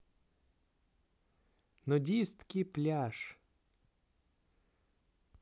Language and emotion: Russian, positive